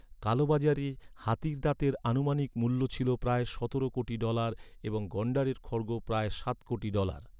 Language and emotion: Bengali, neutral